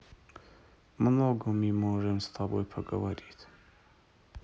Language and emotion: Russian, sad